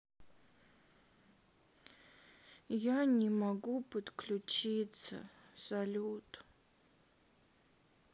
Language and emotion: Russian, sad